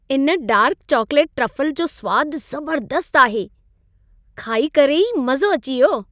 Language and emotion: Sindhi, happy